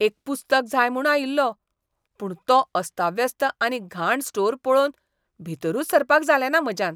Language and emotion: Goan Konkani, disgusted